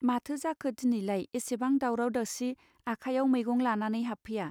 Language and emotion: Bodo, neutral